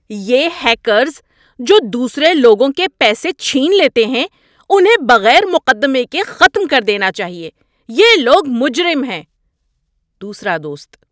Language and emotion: Urdu, angry